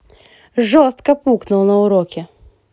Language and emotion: Russian, angry